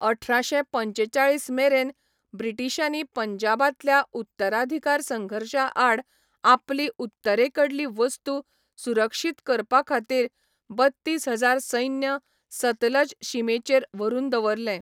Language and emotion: Goan Konkani, neutral